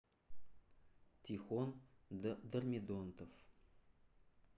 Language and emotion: Russian, neutral